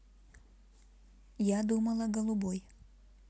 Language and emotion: Russian, neutral